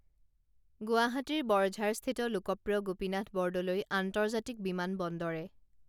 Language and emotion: Assamese, neutral